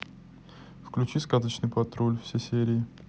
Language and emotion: Russian, neutral